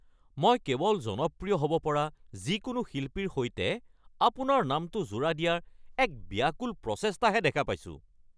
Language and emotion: Assamese, angry